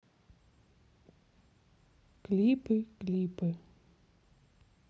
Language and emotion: Russian, sad